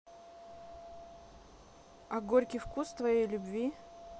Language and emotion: Russian, neutral